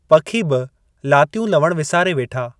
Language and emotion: Sindhi, neutral